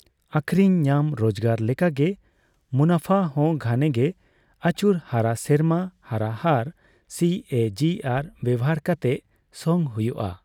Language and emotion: Santali, neutral